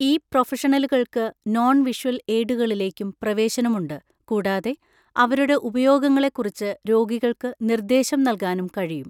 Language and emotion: Malayalam, neutral